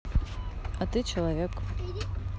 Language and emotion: Russian, neutral